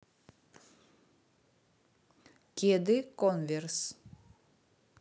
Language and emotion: Russian, neutral